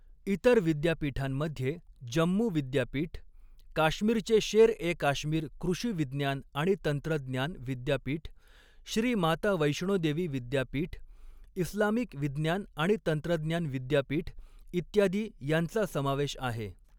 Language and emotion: Marathi, neutral